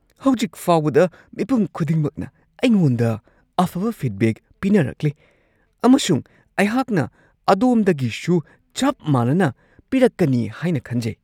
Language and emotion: Manipuri, surprised